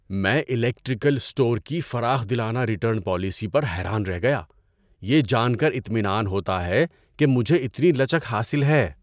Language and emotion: Urdu, surprised